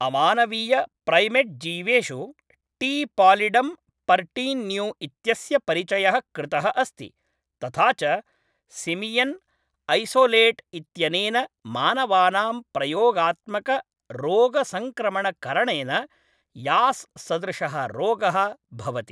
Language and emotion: Sanskrit, neutral